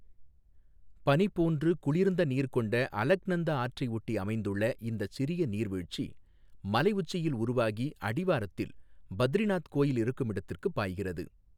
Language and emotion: Tamil, neutral